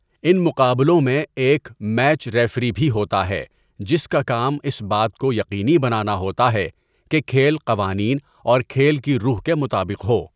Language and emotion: Urdu, neutral